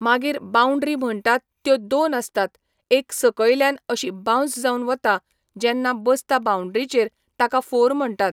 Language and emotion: Goan Konkani, neutral